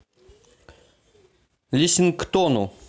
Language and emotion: Russian, neutral